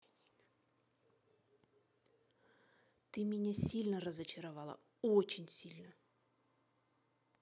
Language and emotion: Russian, angry